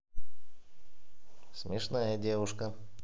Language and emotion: Russian, positive